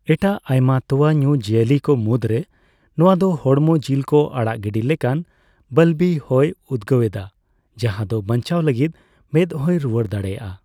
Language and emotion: Santali, neutral